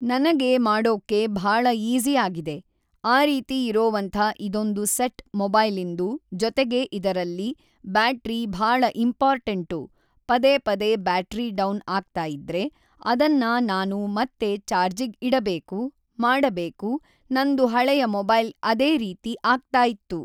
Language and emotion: Kannada, neutral